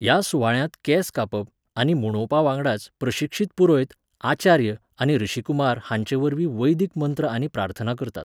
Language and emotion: Goan Konkani, neutral